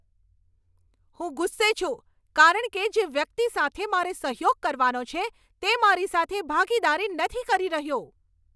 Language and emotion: Gujarati, angry